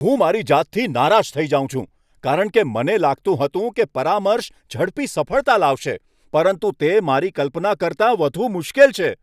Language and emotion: Gujarati, angry